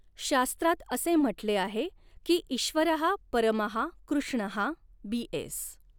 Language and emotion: Marathi, neutral